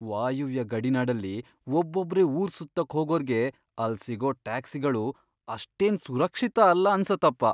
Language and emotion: Kannada, fearful